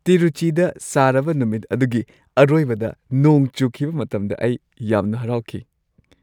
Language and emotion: Manipuri, happy